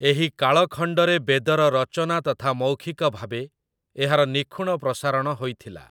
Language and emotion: Odia, neutral